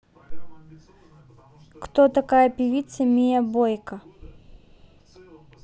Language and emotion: Russian, neutral